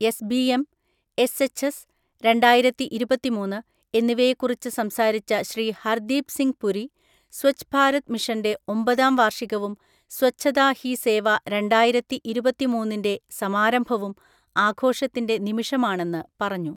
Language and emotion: Malayalam, neutral